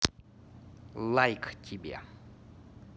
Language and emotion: Russian, positive